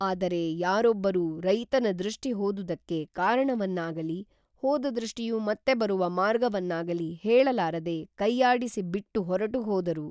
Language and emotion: Kannada, neutral